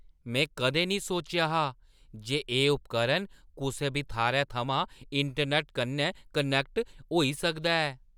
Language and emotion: Dogri, surprised